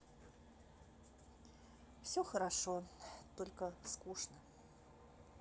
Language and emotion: Russian, sad